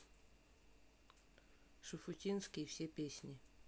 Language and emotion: Russian, neutral